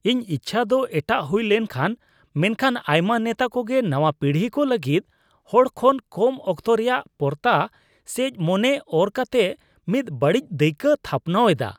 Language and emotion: Santali, disgusted